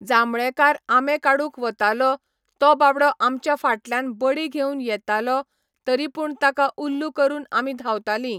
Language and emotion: Goan Konkani, neutral